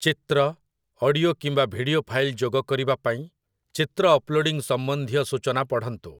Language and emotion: Odia, neutral